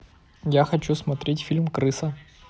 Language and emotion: Russian, neutral